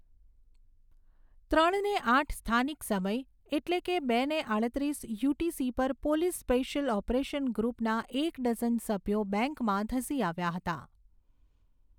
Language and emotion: Gujarati, neutral